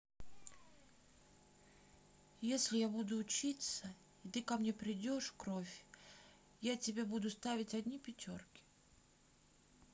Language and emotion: Russian, sad